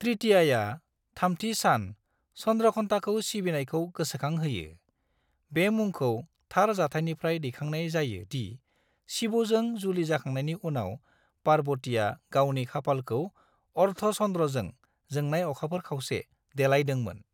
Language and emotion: Bodo, neutral